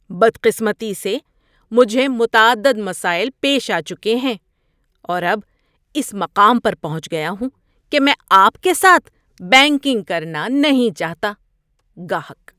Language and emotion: Urdu, disgusted